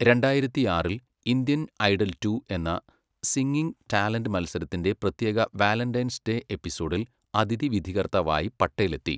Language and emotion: Malayalam, neutral